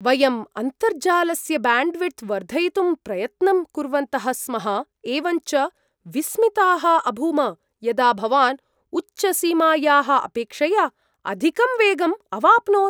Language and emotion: Sanskrit, surprised